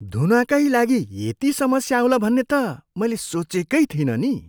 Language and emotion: Nepali, surprised